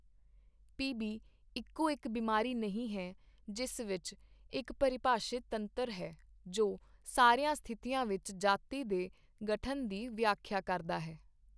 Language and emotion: Punjabi, neutral